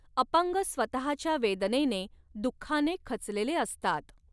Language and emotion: Marathi, neutral